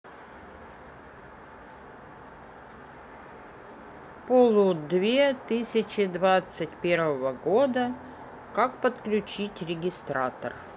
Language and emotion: Russian, neutral